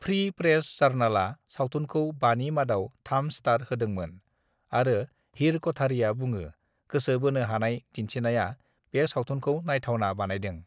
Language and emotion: Bodo, neutral